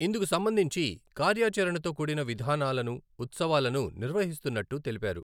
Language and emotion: Telugu, neutral